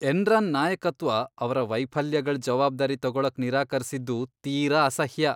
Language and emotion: Kannada, disgusted